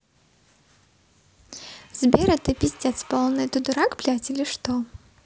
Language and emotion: Russian, neutral